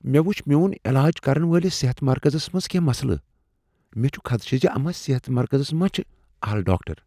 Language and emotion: Kashmiri, fearful